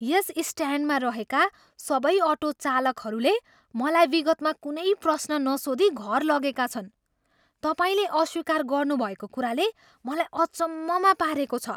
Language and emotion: Nepali, surprised